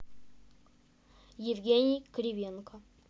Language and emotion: Russian, neutral